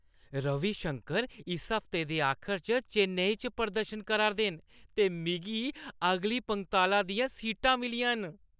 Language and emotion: Dogri, happy